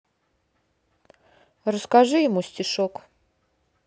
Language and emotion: Russian, neutral